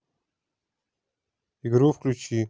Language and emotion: Russian, neutral